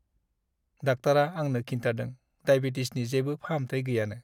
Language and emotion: Bodo, sad